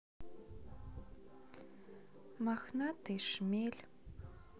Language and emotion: Russian, neutral